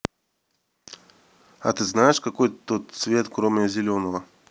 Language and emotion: Russian, neutral